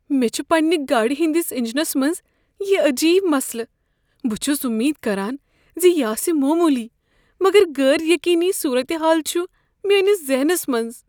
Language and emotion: Kashmiri, fearful